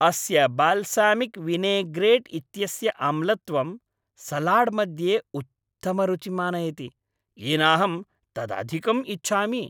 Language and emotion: Sanskrit, happy